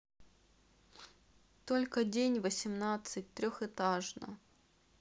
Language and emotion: Russian, neutral